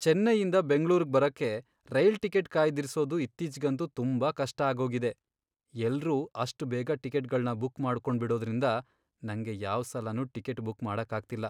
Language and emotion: Kannada, sad